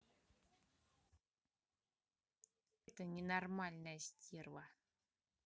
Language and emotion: Russian, angry